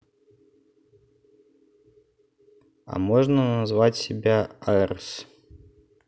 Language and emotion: Russian, neutral